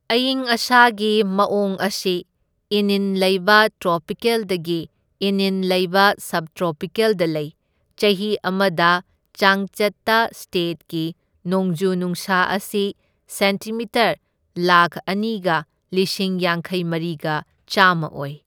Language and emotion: Manipuri, neutral